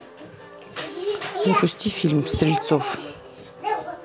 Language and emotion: Russian, neutral